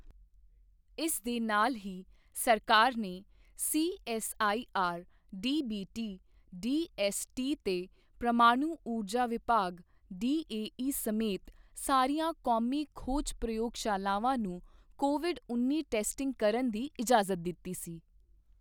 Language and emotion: Punjabi, neutral